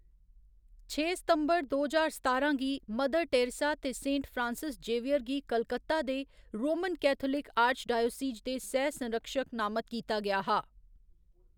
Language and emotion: Dogri, neutral